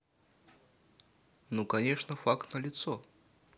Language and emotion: Russian, neutral